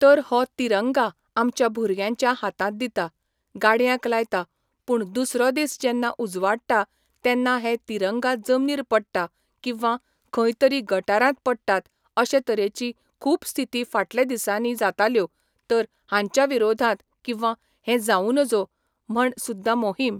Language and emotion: Goan Konkani, neutral